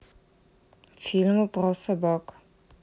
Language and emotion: Russian, neutral